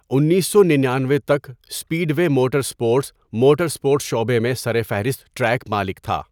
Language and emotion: Urdu, neutral